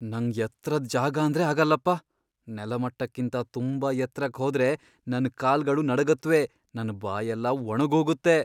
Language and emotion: Kannada, fearful